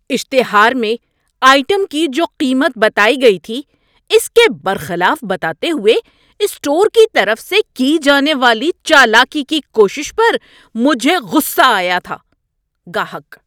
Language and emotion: Urdu, angry